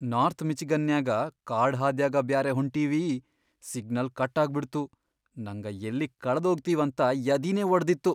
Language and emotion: Kannada, fearful